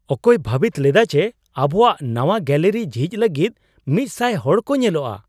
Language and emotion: Santali, surprised